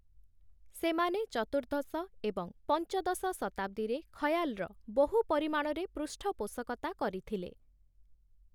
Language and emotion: Odia, neutral